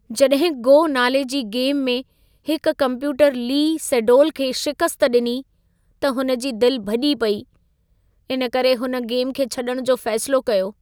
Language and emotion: Sindhi, sad